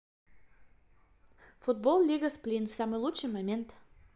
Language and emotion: Russian, positive